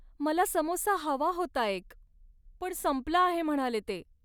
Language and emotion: Marathi, sad